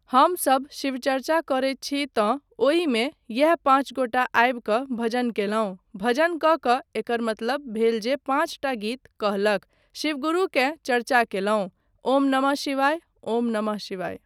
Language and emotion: Maithili, neutral